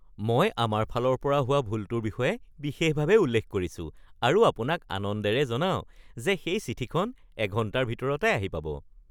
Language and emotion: Assamese, happy